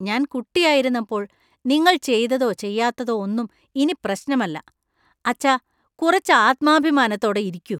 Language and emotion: Malayalam, disgusted